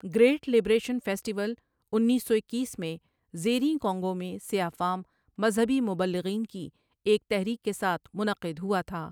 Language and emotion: Urdu, neutral